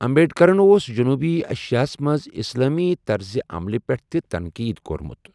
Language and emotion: Kashmiri, neutral